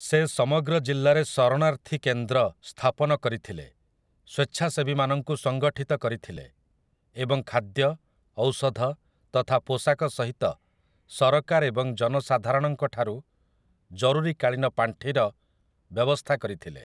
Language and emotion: Odia, neutral